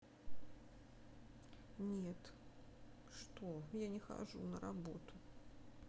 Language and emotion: Russian, sad